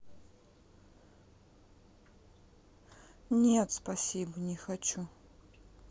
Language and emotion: Russian, sad